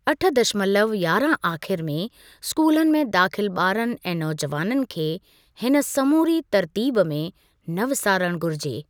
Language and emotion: Sindhi, neutral